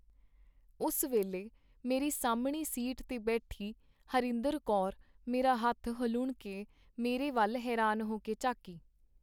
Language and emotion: Punjabi, neutral